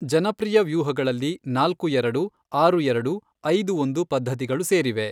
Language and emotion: Kannada, neutral